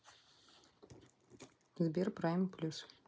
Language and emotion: Russian, neutral